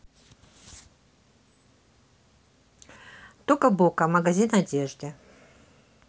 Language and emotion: Russian, neutral